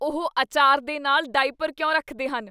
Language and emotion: Punjabi, disgusted